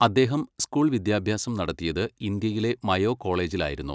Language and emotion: Malayalam, neutral